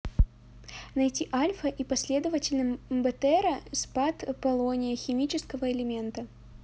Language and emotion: Russian, neutral